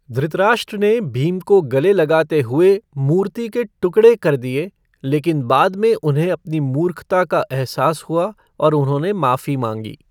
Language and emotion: Hindi, neutral